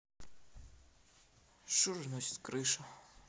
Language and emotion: Russian, sad